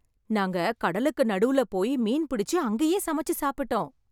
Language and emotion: Tamil, happy